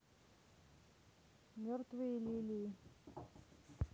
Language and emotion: Russian, neutral